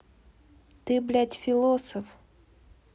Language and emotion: Russian, angry